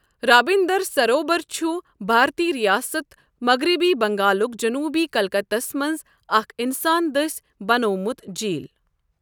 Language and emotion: Kashmiri, neutral